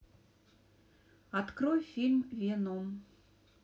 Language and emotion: Russian, neutral